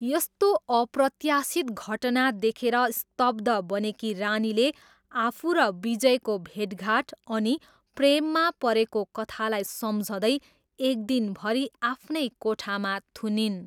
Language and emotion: Nepali, neutral